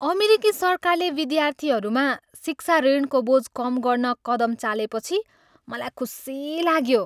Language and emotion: Nepali, happy